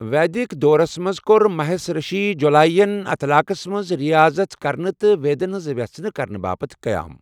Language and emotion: Kashmiri, neutral